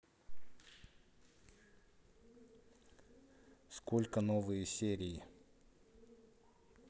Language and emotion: Russian, neutral